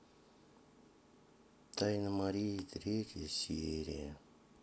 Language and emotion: Russian, sad